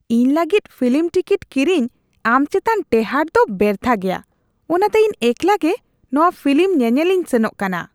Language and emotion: Santali, disgusted